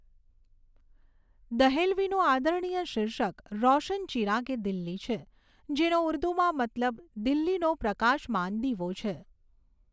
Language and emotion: Gujarati, neutral